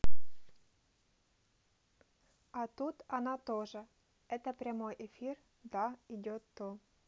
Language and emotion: Russian, neutral